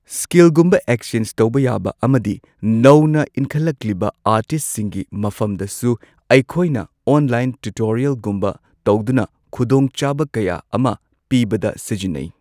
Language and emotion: Manipuri, neutral